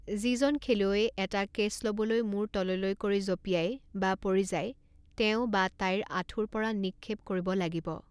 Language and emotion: Assamese, neutral